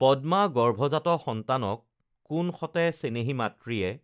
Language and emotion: Assamese, neutral